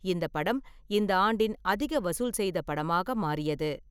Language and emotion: Tamil, neutral